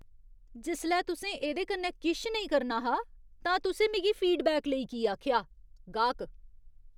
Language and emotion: Dogri, disgusted